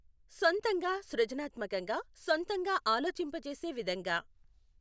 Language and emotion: Telugu, neutral